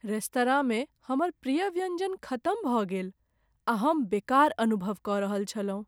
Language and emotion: Maithili, sad